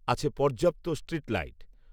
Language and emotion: Bengali, neutral